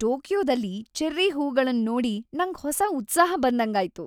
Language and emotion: Kannada, happy